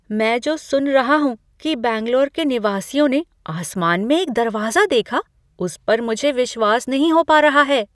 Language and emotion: Hindi, surprised